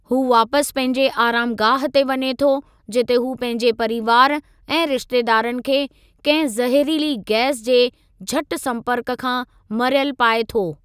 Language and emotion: Sindhi, neutral